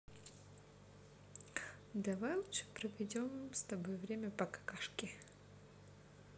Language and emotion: Russian, neutral